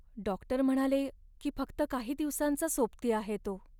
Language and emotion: Marathi, sad